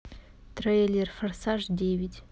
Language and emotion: Russian, neutral